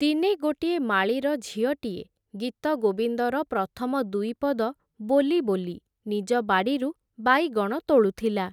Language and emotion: Odia, neutral